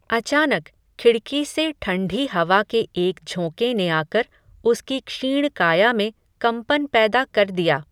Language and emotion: Hindi, neutral